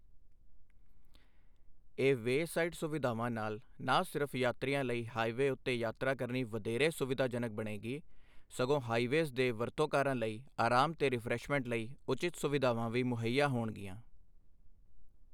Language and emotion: Punjabi, neutral